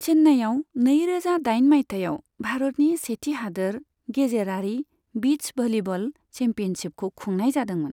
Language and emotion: Bodo, neutral